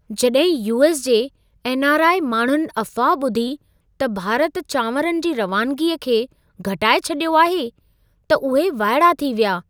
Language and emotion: Sindhi, surprised